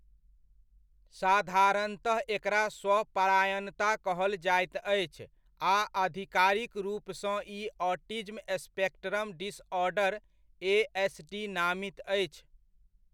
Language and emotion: Maithili, neutral